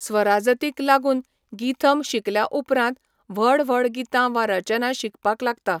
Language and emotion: Goan Konkani, neutral